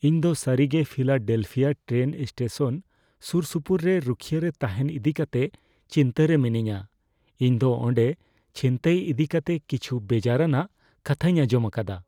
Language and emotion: Santali, fearful